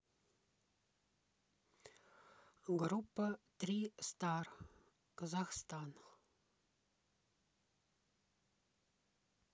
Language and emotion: Russian, neutral